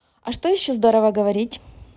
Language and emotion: Russian, positive